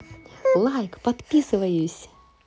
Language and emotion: Russian, positive